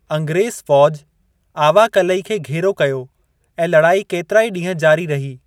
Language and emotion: Sindhi, neutral